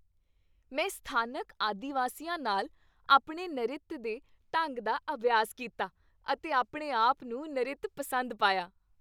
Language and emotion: Punjabi, happy